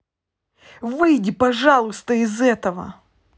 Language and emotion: Russian, angry